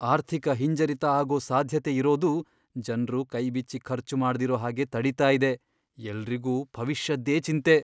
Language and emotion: Kannada, fearful